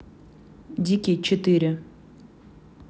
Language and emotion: Russian, neutral